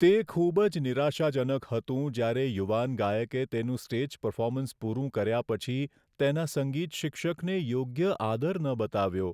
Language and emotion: Gujarati, sad